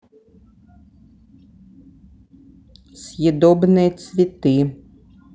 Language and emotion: Russian, neutral